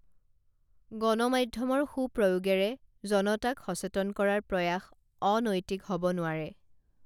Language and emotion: Assamese, neutral